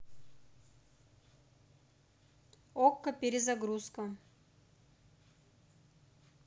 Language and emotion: Russian, neutral